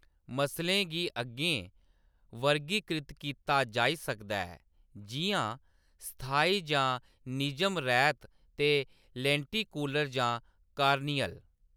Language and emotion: Dogri, neutral